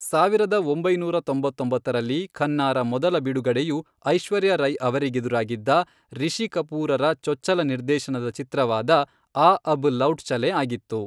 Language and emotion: Kannada, neutral